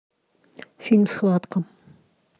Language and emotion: Russian, neutral